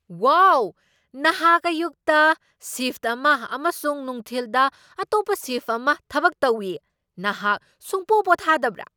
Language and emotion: Manipuri, surprised